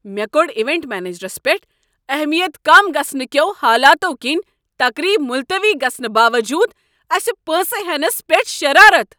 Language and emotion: Kashmiri, angry